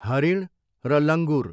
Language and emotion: Nepali, neutral